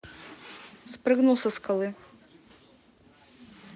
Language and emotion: Russian, neutral